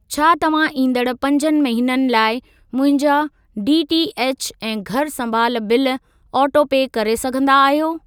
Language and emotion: Sindhi, neutral